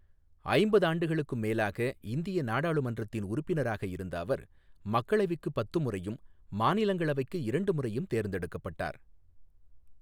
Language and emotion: Tamil, neutral